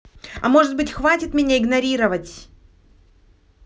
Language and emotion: Russian, angry